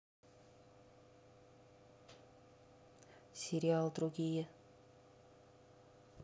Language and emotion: Russian, neutral